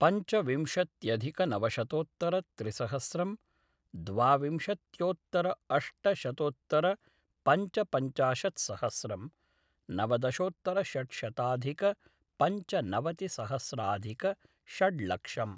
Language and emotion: Sanskrit, neutral